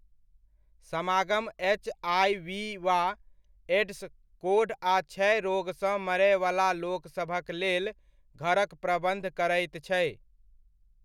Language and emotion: Maithili, neutral